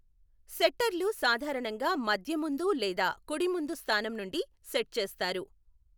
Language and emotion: Telugu, neutral